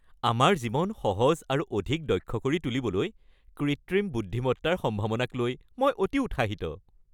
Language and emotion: Assamese, happy